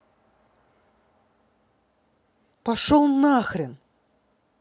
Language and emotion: Russian, angry